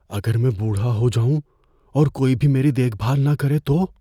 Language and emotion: Urdu, fearful